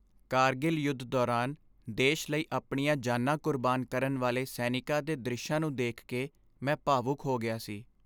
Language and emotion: Punjabi, sad